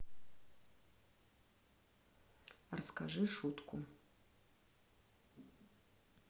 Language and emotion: Russian, neutral